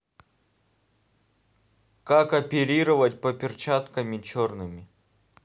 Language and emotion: Russian, neutral